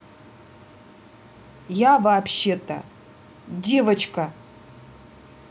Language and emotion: Russian, angry